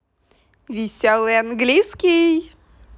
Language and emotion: Russian, positive